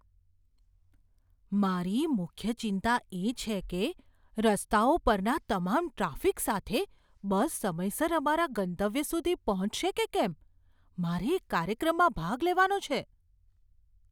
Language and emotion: Gujarati, fearful